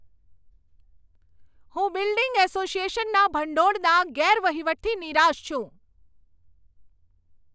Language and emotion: Gujarati, angry